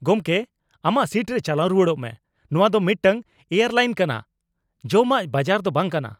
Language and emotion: Santali, angry